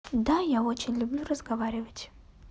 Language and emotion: Russian, neutral